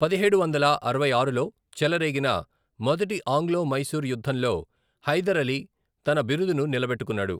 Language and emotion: Telugu, neutral